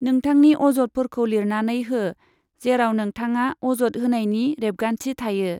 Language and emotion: Bodo, neutral